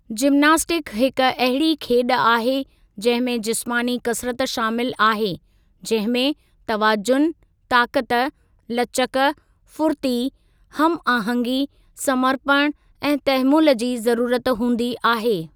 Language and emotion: Sindhi, neutral